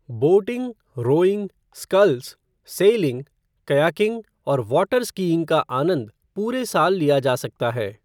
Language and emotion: Hindi, neutral